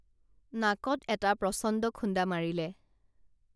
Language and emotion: Assamese, neutral